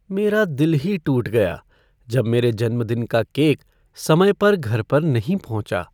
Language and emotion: Hindi, sad